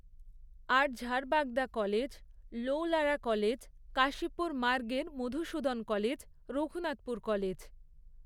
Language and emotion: Bengali, neutral